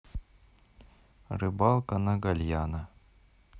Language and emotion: Russian, neutral